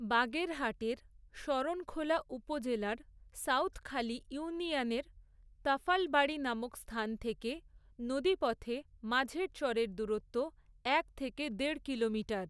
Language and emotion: Bengali, neutral